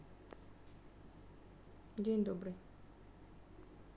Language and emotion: Russian, neutral